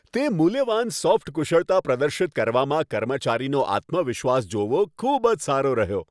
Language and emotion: Gujarati, happy